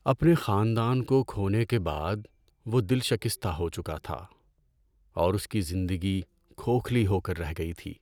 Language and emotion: Urdu, sad